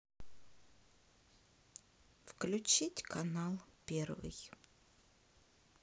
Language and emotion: Russian, neutral